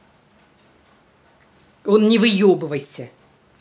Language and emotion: Russian, angry